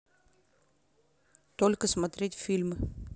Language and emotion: Russian, neutral